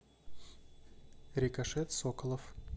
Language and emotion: Russian, neutral